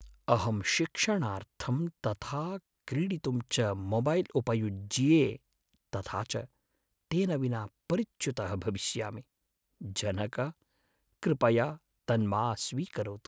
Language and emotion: Sanskrit, sad